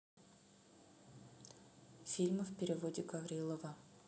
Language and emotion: Russian, neutral